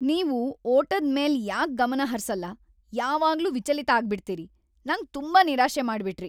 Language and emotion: Kannada, angry